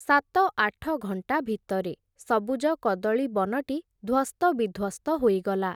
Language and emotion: Odia, neutral